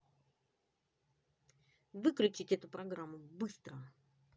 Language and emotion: Russian, angry